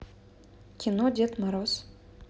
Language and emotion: Russian, neutral